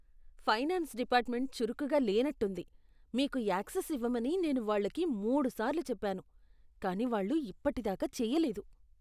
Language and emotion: Telugu, disgusted